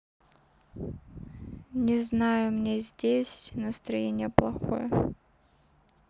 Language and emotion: Russian, sad